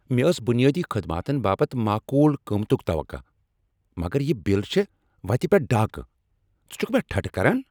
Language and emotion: Kashmiri, angry